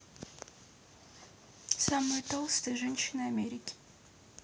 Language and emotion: Russian, neutral